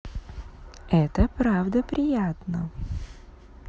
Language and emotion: Russian, positive